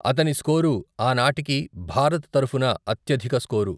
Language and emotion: Telugu, neutral